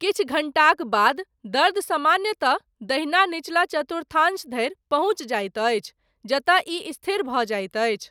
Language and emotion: Maithili, neutral